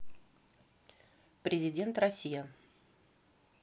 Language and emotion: Russian, neutral